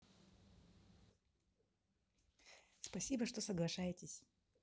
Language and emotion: Russian, positive